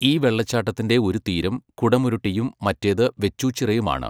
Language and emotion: Malayalam, neutral